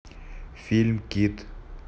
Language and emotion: Russian, neutral